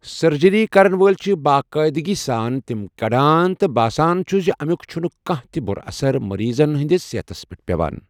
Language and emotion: Kashmiri, neutral